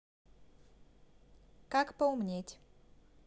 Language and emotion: Russian, neutral